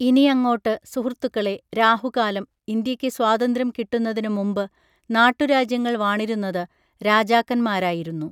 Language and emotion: Malayalam, neutral